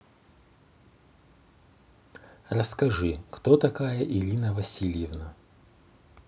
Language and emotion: Russian, neutral